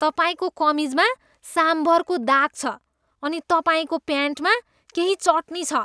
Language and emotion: Nepali, disgusted